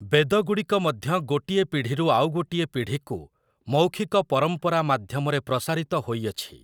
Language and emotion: Odia, neutral